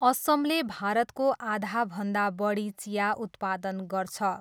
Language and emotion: Nepali, neutral